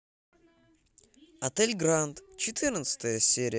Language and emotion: Russian, positive